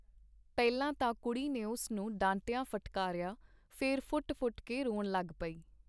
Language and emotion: Punjabi, neutral